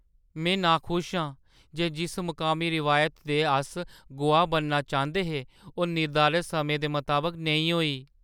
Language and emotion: Dogri, sad